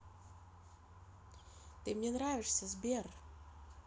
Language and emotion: Russian, neutral